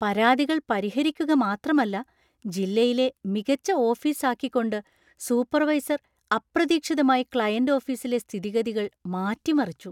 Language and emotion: Malayalam, surprised